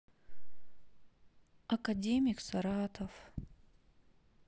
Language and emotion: Russian, sad